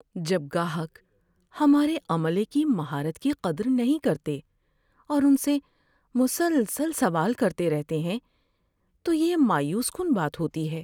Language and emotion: Urdu, sad